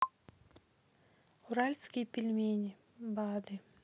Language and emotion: Russian, sad